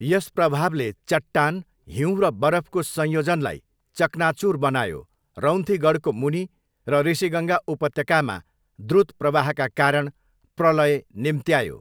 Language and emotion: Nepali, neutral